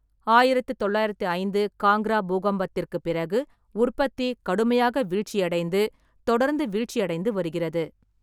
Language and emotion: Tamil, neutral